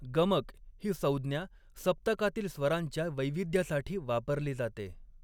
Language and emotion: Marathi, neutral